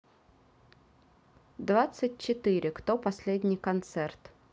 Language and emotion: Russian, neutral